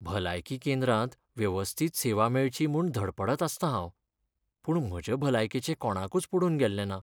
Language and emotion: Goan Konkani, sad